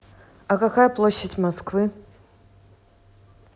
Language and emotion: Russian, neutral